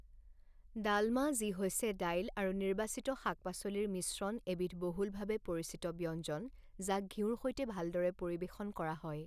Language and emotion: Assamese, neutral